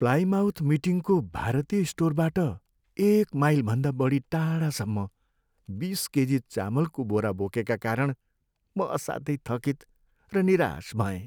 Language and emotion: Nepali, sad